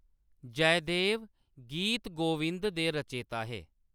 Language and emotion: Dogri, neutral